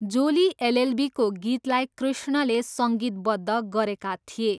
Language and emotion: Nepali, neutral